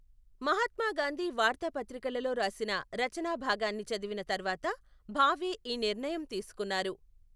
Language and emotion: Telugu, neutral